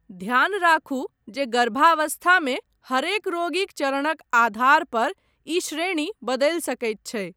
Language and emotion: Maithili, neutral